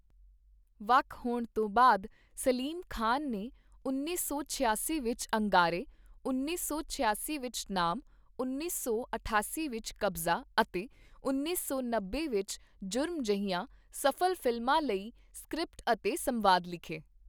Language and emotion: Punjabi, neutral